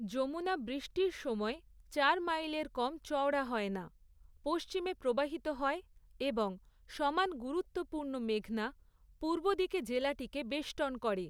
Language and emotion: Bengali, neutral